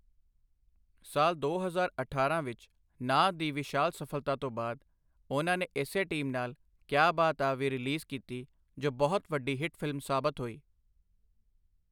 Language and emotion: Punjabi, neutral